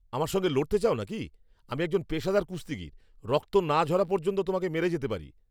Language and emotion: Bengali, angry